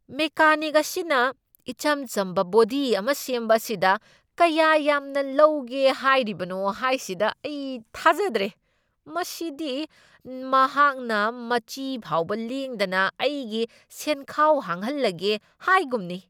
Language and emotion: Manipuri, angry